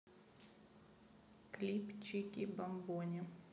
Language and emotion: Russian, neutral